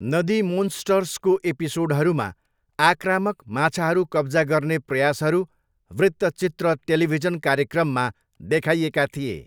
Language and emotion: Nepali, neutral